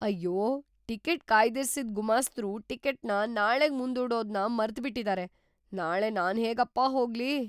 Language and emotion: Kannada, surprised